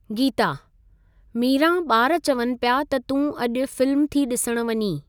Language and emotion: Sindhi, neutral